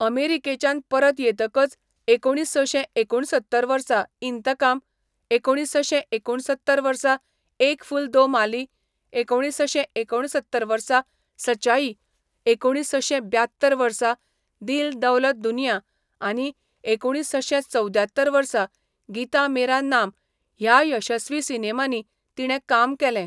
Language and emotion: Goan Konkani, neutral